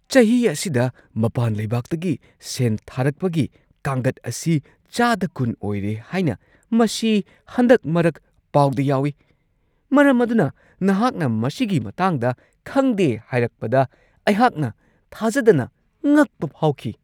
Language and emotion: Manipuri, surprised